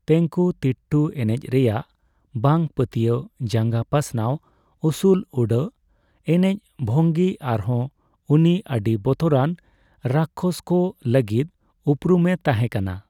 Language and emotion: Santali, neutral